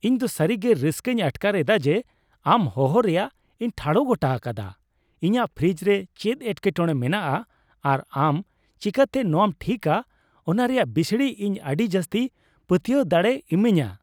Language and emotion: Santali, happy